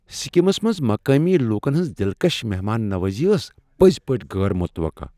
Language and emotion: Kashmiri, surprised